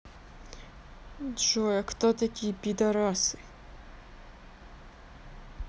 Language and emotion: Russian, neutral